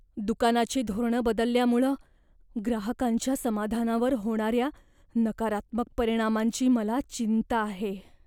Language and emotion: Marathi, fearful